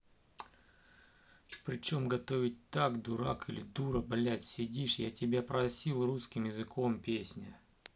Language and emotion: Russian, angry